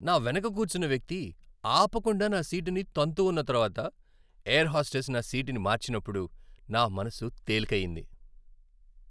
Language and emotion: Telugu, happy